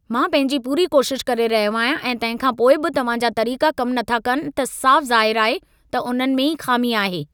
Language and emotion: Sindhi, angry